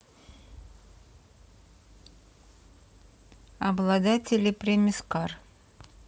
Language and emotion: Russian, neutral